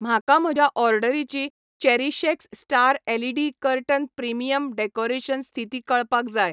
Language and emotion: Goan Konkani, neutral